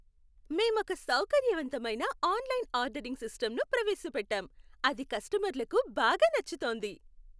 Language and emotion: Telugu, happy